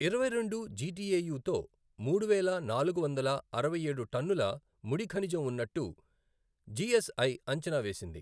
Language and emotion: Telugu, neutral